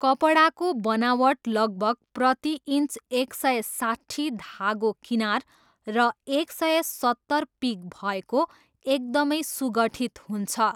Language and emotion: Nepali, neutral